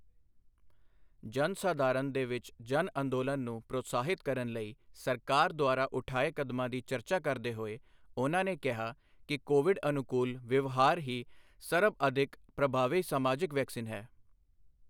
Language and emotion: Punjabi, neutral